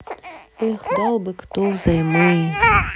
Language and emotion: Russian, sad